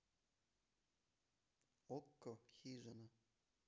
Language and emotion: Russian, neutral